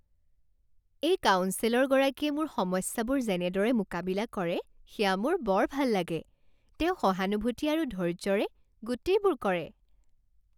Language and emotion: Assamese, happy